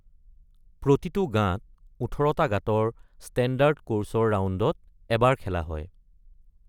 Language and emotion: Assamese, neutral